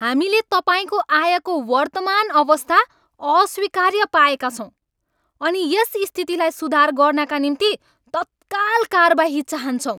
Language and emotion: Nepali, angry